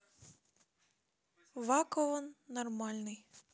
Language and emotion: Russian, neutral